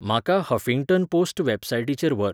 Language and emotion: Goan Konkani, neutral